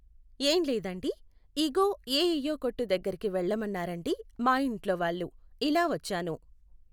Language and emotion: Telugu, neutral